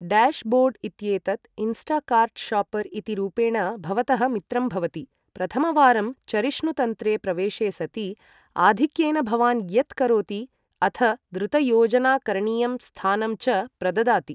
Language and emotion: Sanskrit, neutral